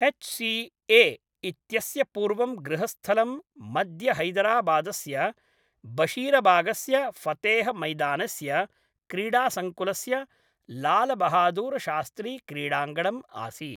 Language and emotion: Sanskrit, neutral